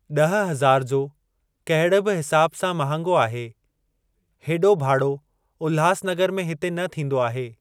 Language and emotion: Sindhi, neutral